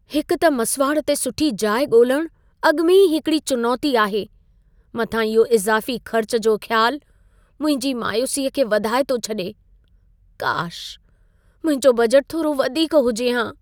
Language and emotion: Sindhi, sad